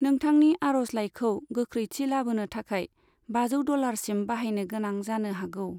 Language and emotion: Bodo, neutral